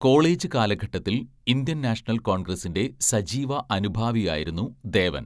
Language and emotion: Malayalam, neutral